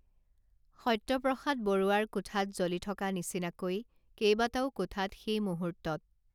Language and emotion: Assamese, neutral